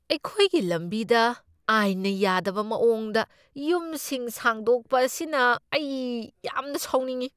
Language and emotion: Manipuri, angry